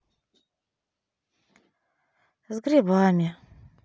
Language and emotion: Russian, sad